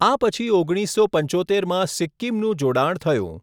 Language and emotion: Gujarati, neutral